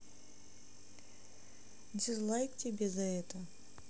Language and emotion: Russian, neutral